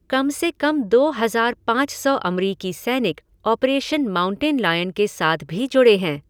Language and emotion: Hindi, neutral